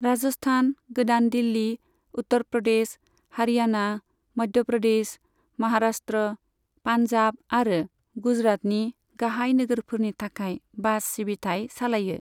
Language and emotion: Bodo, neutral